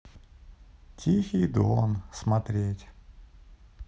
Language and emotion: Russian, sad